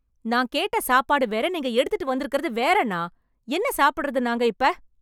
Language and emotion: Tamil, angry